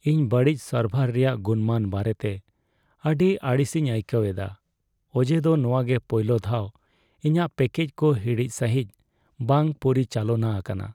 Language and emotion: Santali, sad